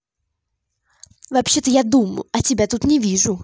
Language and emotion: Russian, angry